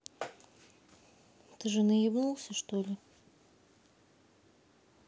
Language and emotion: Russian, neutral